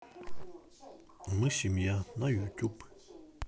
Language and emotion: Russian, neutral